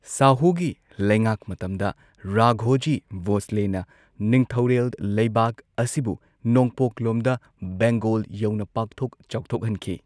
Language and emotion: Manipuri, neutral